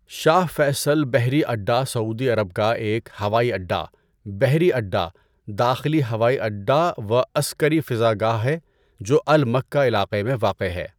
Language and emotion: Urdu, neutral